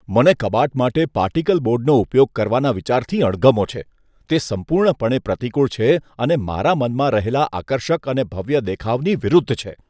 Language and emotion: Gujarati, disgusted